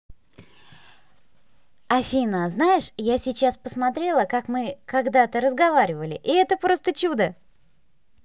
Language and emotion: Russian, positive